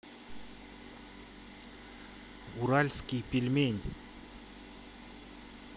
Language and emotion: Russian, positive